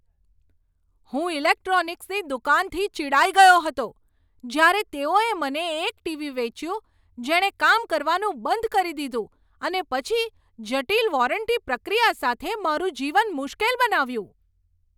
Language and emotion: Gujarati, angry